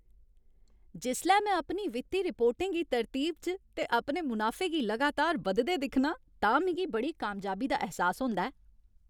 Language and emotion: Dogri, happy